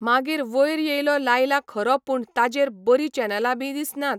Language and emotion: Goan Konkani, neutral